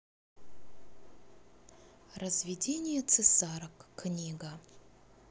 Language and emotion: Russian, neutral